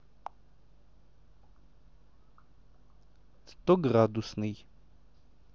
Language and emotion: Russian, neutral